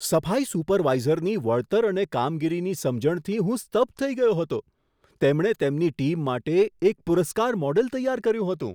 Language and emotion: Gujarati, surprised